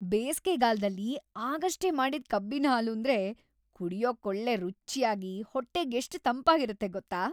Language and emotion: Kannada, happy